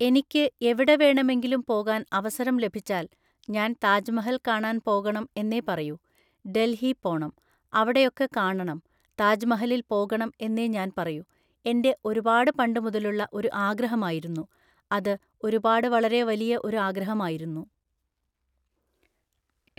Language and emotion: Malayalam, neutral